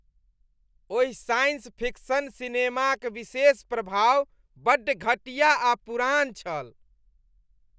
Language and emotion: Maithili, disgusted